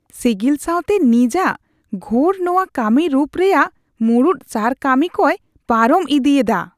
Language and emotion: Santali, disgusted